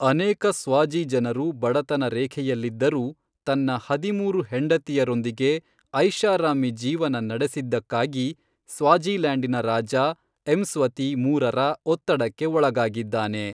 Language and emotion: Kannada, neutral